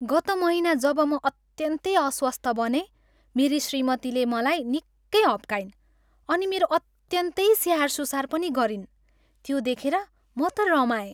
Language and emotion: Nepali, happy